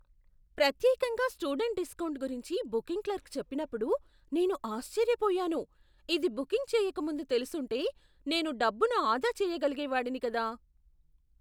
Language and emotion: Telugu, surprised